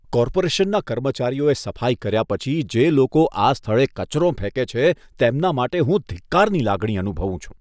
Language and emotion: Gujarati, disgusted